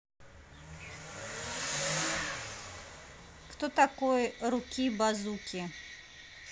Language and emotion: Russian, neutral